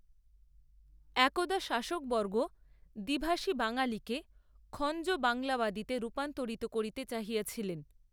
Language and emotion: Bengali, neutral